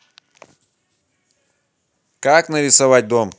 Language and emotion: Russian, neutral